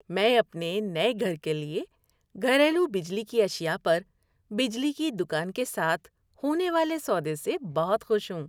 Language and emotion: Urdu, happy